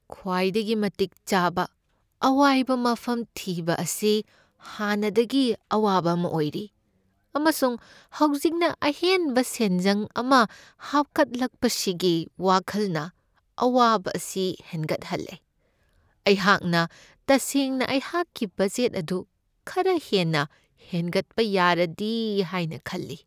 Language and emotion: Manipuri, sad